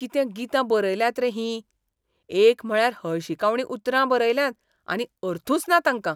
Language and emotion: Goan Konkani, disgusted